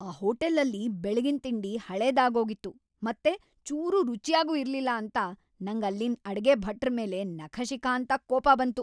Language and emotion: Kannada, angry